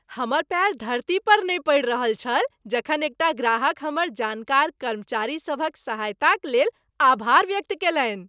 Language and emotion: Maithili, happy